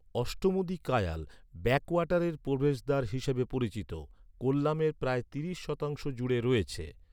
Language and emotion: Bengali, neutral